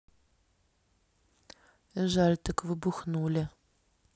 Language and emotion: Russian, sad